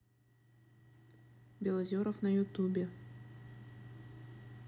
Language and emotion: Russian, neutral